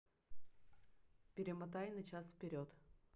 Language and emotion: Russian, neutral